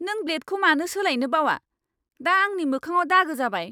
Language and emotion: Bodo, angry